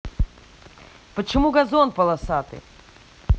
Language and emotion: Russian, angry